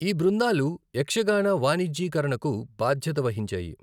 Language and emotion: Telugu, neutral